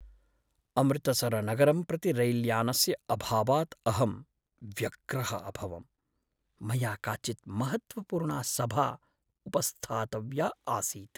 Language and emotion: Sanskrit, sad